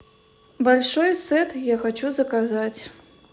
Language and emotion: Russian, neutral